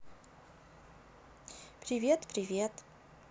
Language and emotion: Russian, neutral